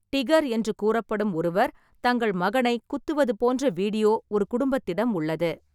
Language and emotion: Tamil, neutral